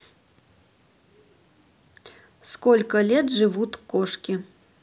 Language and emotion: Russian, neutral